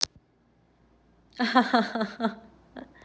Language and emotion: Russian, positive